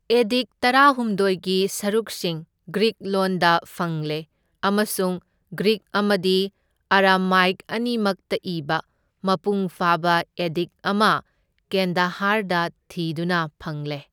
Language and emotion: Manipuri, neutral